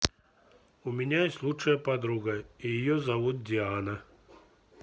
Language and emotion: Russian, neutral